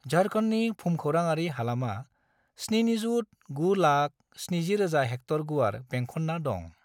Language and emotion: Bodo, neutral